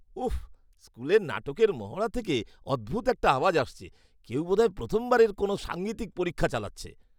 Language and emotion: Bengali, disgusted